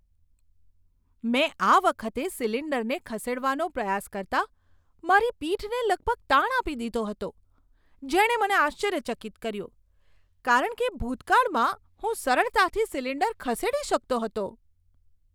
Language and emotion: Gujarati, surprised